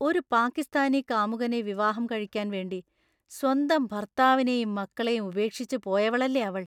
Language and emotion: Malayalam, disgusted